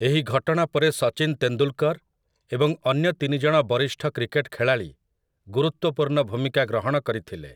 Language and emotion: Odia, neutral